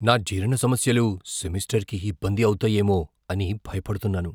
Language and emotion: Telugu, fearful